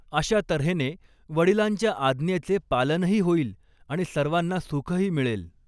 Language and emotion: Marathi, neutral